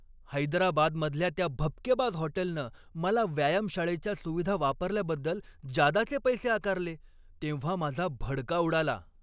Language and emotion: Marathi, angry